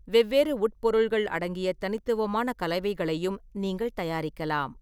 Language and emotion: Tamil, neutral